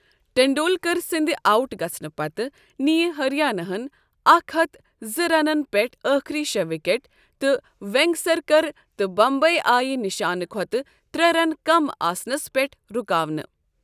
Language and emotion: Kashmiri, neutral